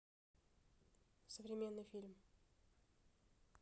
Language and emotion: Russian, neutral